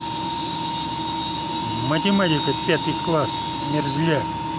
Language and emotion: Russian, angry